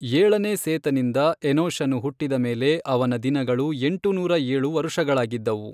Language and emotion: Kannada, neutral